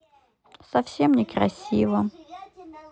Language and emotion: Russian, sad